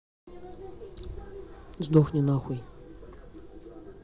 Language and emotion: Russian, angry